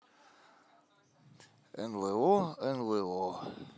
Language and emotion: Russian, positive